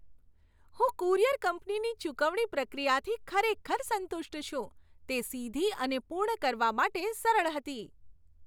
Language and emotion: Gujarati, happy